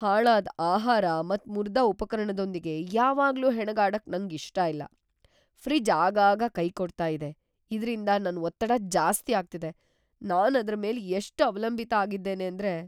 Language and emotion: Kannada, fearful